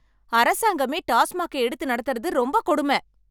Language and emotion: Tamil, angry